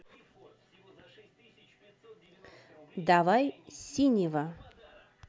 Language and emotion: Russian, neutral